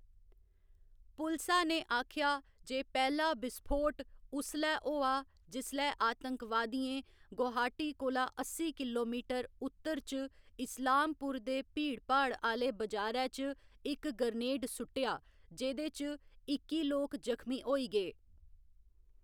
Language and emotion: Dogri, neutral